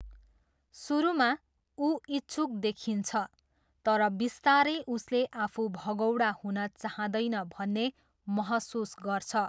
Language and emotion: Nepali, neutral